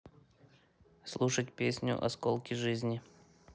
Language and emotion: Russian, neutral